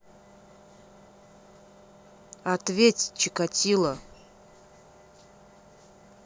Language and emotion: Russian, angry